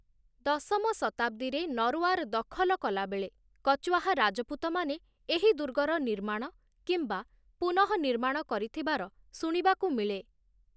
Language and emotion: Odia, neutral